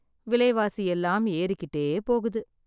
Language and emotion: Tamil, sad